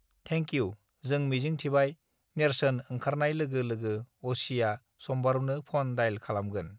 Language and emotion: Bodo, neutral